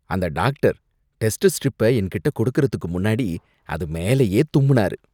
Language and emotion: Tamil, disgusted